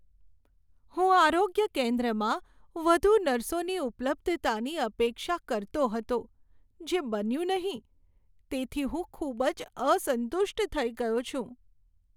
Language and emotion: Gujarati, sad